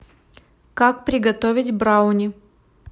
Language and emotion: Russian, neutral